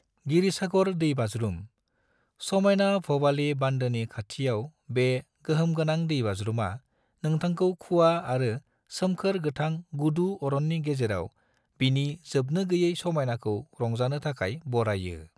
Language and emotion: Bodo, neutral